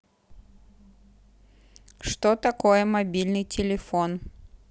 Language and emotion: Russian, neutral